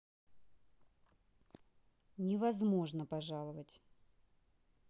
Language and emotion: Russian, neutral